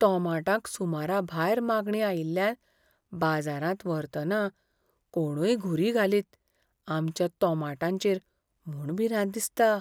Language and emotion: Goan Konkani, fearful